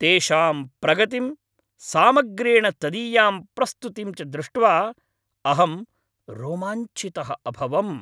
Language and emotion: Sanskrit, happy